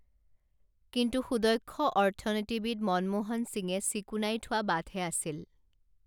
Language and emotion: Assamese, neutral